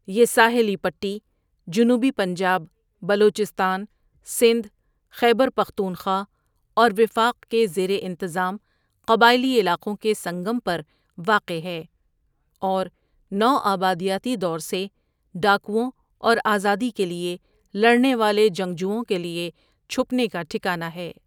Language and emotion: Urdu, neutral